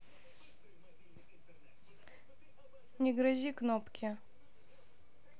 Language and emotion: Russian, neutral